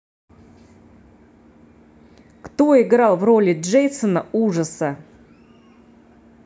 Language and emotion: Russian, neutral